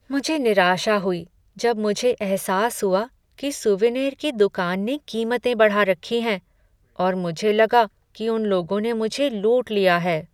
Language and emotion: Hindi, sad